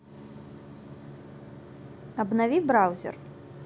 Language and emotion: Russian, neutral